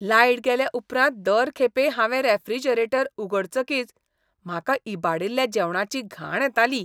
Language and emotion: Goan Konkani, disgusted